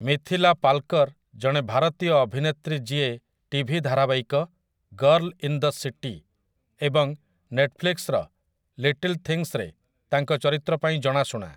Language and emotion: Odia, neutral